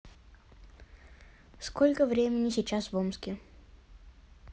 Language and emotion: Russian, neutral